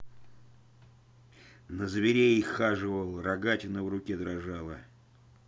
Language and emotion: Russian, angry